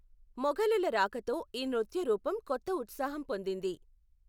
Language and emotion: Telugu, neutral